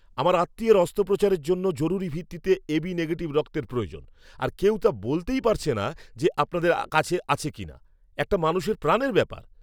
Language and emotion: Bengali, angry